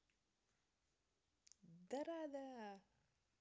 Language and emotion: Russian, positive